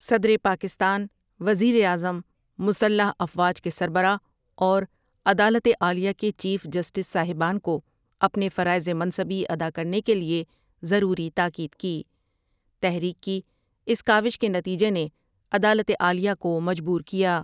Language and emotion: Urdu, neutral